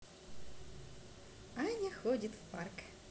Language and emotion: Russian, positive